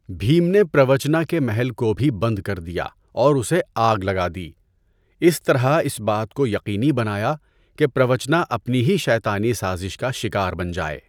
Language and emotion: Urdu, neutral